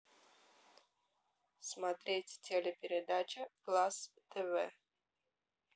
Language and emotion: Russian, neutral